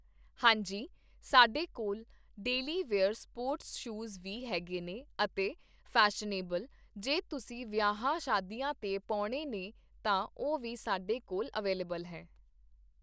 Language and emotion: Punjabi, neutral